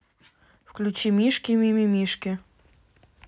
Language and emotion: Russian, neutral